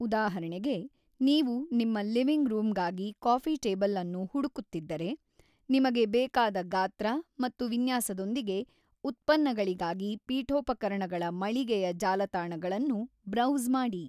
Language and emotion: Kannada, neutral